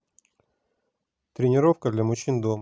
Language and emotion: Russian, neutral